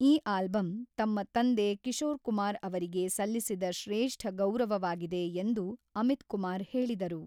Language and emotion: Kannada, neutral